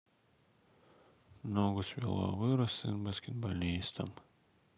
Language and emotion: Russian, sad